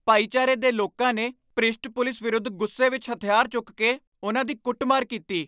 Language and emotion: Punjabi, angry